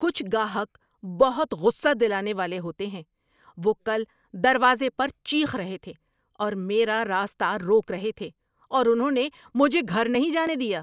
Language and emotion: Urdu, angry